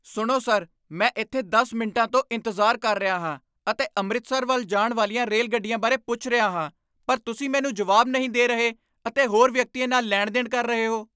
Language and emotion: Punjabi, angry